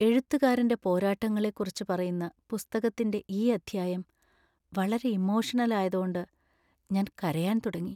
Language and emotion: Malayalam, sad